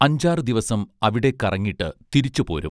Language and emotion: Malayalam, neutral